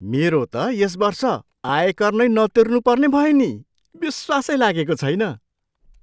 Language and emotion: Nepali, surprised